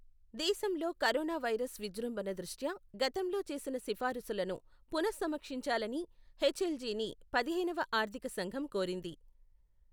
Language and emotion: Telugu, neutral